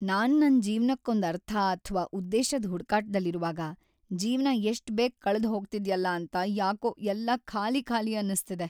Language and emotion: Kannada, sad